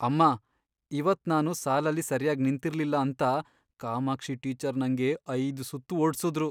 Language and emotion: Kannada, sad